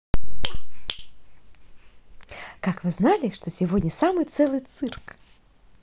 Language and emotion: Russian, positive